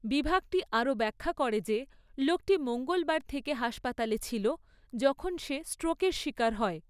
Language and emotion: Bengali, neutral